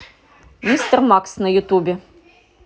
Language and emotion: Russian, positive